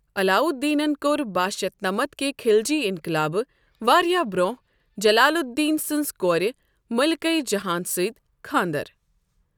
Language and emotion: Kashmiri, neutral